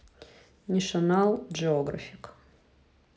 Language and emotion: Russian, neutral